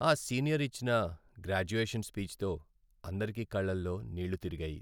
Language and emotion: Telugu, sad